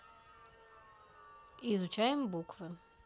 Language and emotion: Russian, neutral